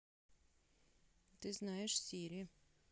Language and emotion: Russian, neutral